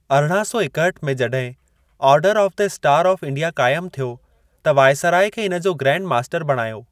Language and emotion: Sindhi, neutral